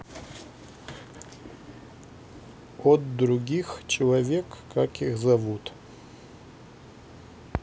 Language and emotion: Russian, neutral